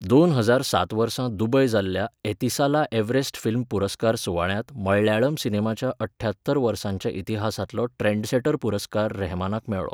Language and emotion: Goan Konkani, neutral